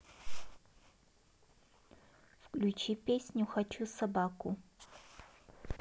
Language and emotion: Russian, neutral